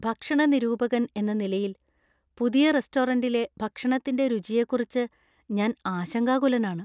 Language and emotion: Malayalam, fearful